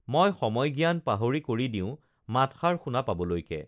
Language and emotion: Assamese, neutral